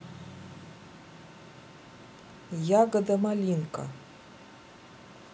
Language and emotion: Russian, neutral